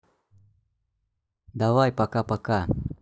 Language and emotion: Russian, neutral